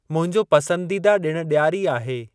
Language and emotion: Sindhi, neutral